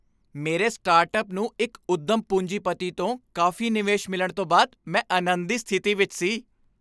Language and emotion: Punjabi, happy